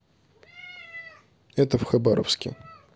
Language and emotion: Russian, neutral